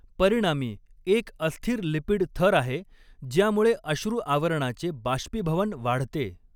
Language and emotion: Marathi, neutral